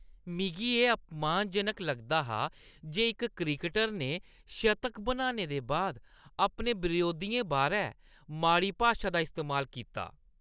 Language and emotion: Dogri, disgusted